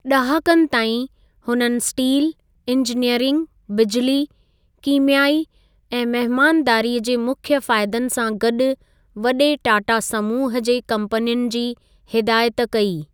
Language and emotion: Sindhi, neutral